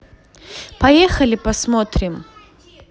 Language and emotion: Russian, positive